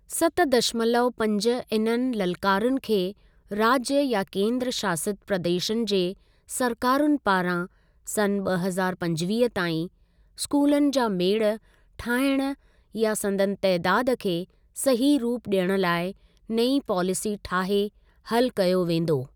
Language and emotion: Sindhi, neutral